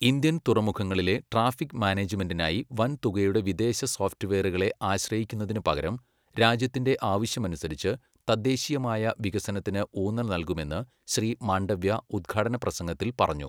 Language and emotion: Malayalam, neutral